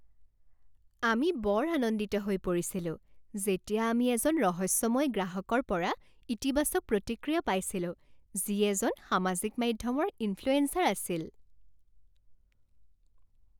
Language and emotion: Assamese, happy